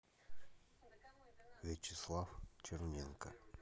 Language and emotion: Russian, neutral